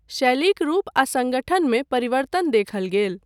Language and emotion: Maithili, neutral